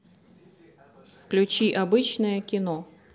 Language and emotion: Russian, neutral